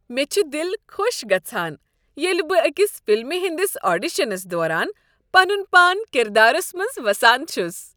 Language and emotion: Kashmiri, happy